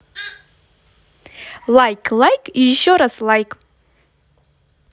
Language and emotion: Russian, positive